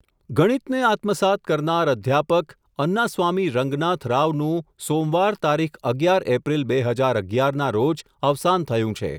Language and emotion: Gujarati, neutral